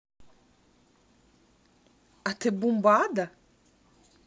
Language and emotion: Russian, neutral